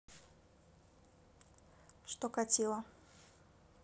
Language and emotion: Russian, neutral